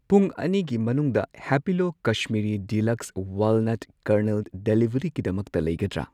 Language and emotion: Manipuri, neutral